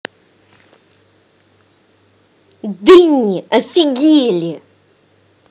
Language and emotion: Russian, angry